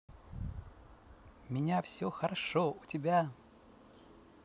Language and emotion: Russian, positive